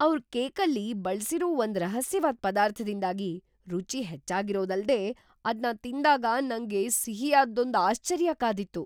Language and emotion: Kannada, surprised